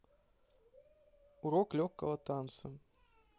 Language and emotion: Russian, neutral